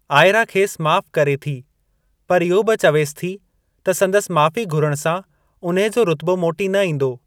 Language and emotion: Sindhi, neutral